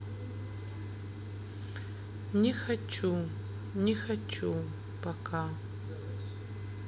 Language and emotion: Russian, sad